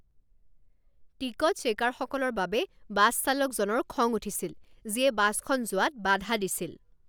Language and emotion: Assamese, angry